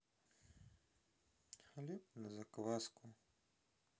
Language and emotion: Russian, sad